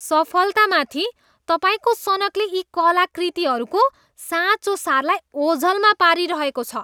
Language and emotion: Nepali, disgusted